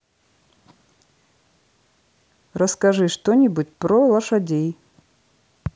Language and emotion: Russian, neutral